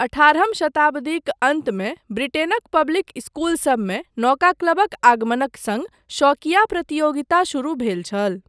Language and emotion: Maithili, neutral